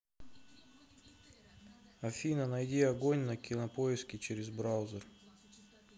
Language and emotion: Russian, neutral